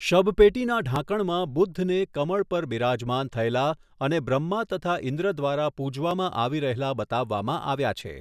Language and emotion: Gujarati, neutral